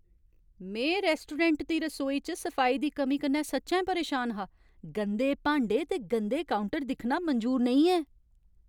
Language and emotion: Dogri, angry